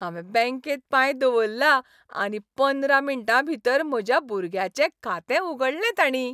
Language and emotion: Goan Konkani, happy